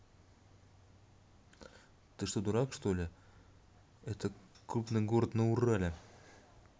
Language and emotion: Russian, angry